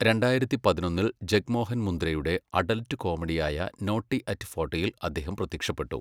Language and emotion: Malayalam, neutral